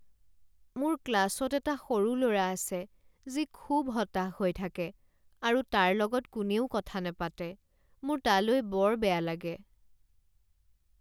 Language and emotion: Assamese, sad